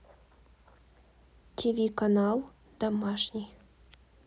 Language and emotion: Russian, neutral